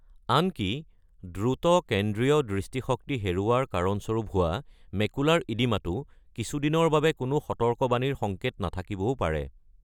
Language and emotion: Assamese, neutral